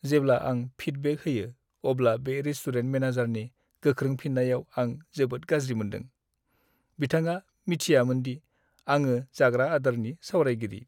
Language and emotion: Bodo, sad